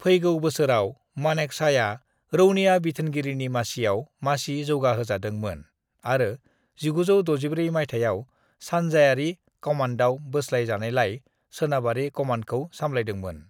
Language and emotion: Bodo, neutral